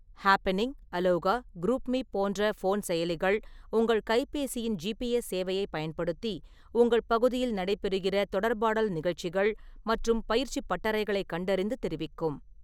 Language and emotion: Tamil, neutral